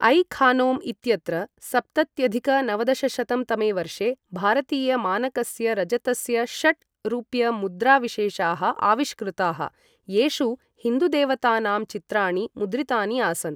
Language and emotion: Sanskrit, neutral